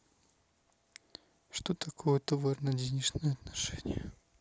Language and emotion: Russian, sad